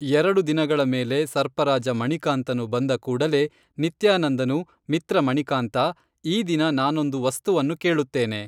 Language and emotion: Kannada, neutral